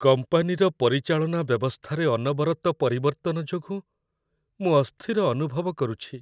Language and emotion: Odia, sad